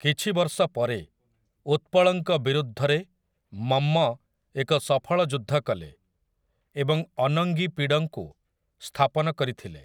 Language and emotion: Odia, neutral